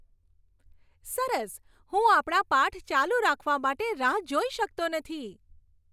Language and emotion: Gujarati, happy